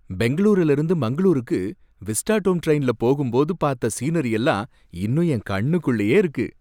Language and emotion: Tamil, happy